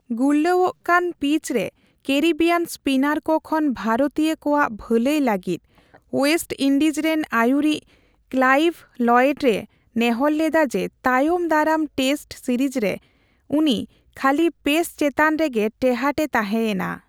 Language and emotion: Santali, neutral